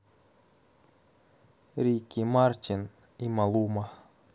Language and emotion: Russian, neutral